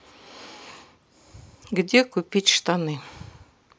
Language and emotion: Russian, sad